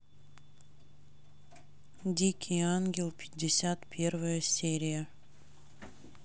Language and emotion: Russian, neutral